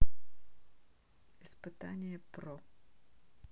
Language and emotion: Russian, neutral